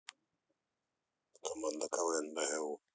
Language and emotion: Russian, neutral